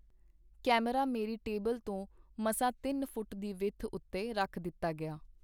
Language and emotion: Punjabi, neutral